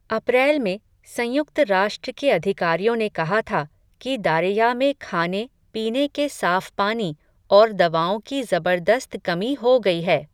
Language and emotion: Hindi, neutral